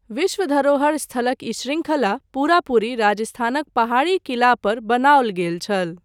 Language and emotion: Maithili, neutral